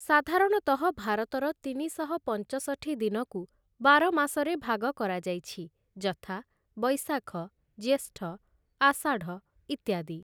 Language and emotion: Odia, neutral